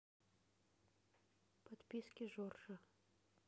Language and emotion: Russian, neutral